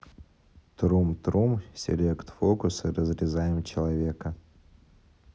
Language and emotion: Russian, neutral